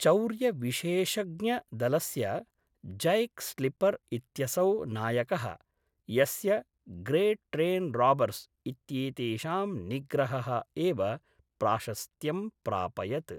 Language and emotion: Sanskrit, neutral